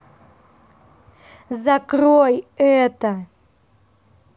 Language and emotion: Russian, angry